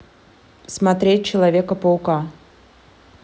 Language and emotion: Russian, neutral